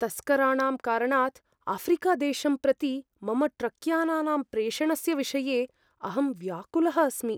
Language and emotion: Sanskrit, fearful